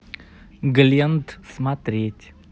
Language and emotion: Russian, neutral